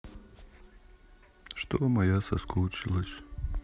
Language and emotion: Russian, sad